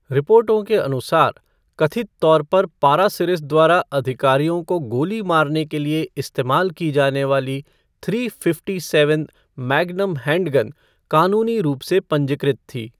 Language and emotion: Hindi, neutral